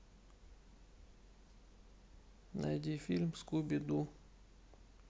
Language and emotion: Russian, sad